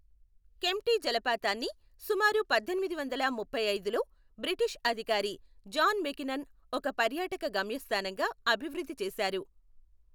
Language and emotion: Telugu, neutral